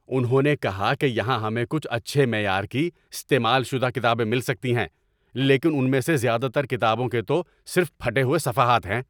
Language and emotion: Urdu, angry